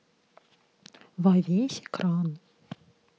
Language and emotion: Russian, neutral